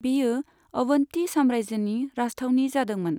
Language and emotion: Bodo, neutral